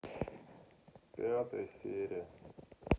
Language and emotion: Russian, sad